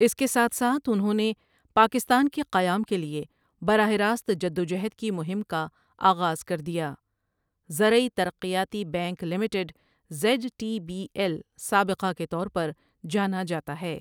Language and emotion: Urdu, neutral